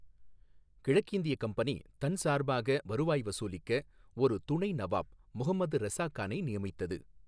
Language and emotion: Tamil, neutral